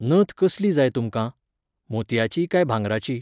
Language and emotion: Goan Konkani, neutral